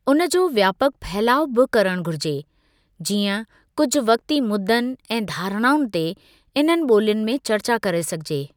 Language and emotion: Sindhi, neutral